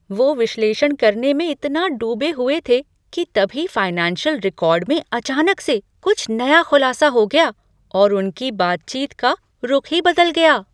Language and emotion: Hindi, surprised